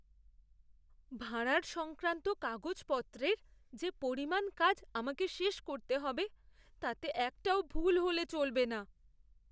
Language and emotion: Bengali, fearful